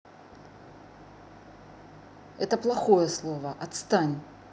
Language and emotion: Russian, angry